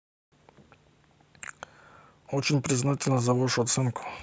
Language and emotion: Russian, neutral